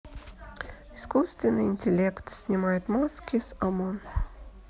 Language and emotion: Russian, neutral